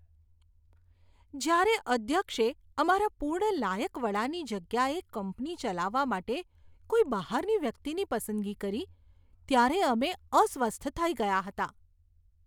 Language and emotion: Gujarati, disgusted